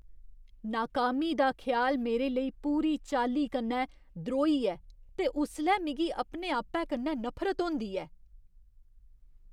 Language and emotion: Dogri, disgusted